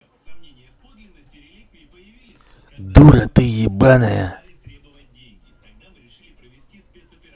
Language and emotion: Russian, angry